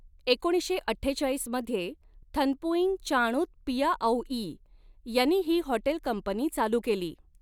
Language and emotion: Marathi, neutral